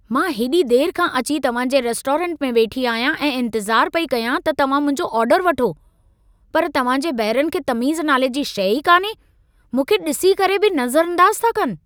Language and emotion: Sindhi, angry